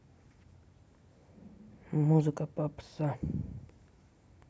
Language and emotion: Russian, neutral